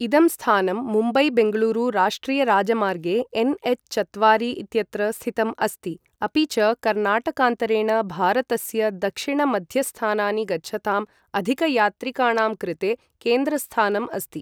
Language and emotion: Sanskrit, neutral